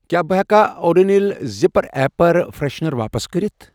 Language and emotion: Kashmiri, neutral